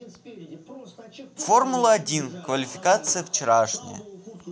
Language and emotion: Russian, neutral